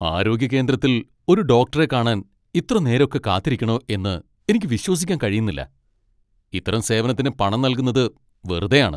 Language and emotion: Malayalam, angry